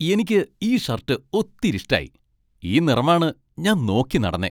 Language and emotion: Malayalam, happy